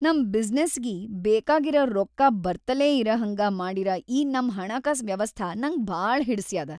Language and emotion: Kannada, happy